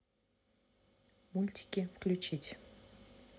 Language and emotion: Russian, neutral